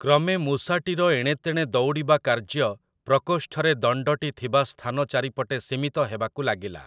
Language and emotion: Odia, neutral